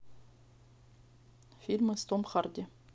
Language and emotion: Russian, neutral